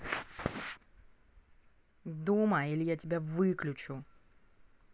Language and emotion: Russian, angry